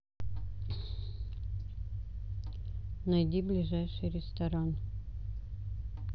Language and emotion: Russian, neutral